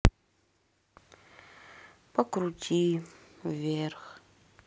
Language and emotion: Russian, sad